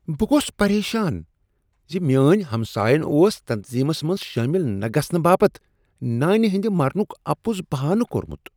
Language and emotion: Kashmiri, disgusted